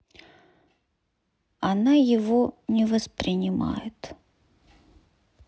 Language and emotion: Russian, sad